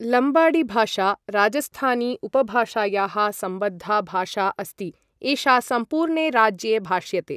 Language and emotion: Sanskrit, neutral